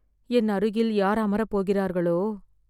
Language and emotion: Tamil, fearful